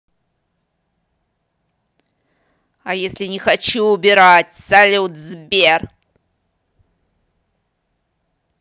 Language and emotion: Russian, angry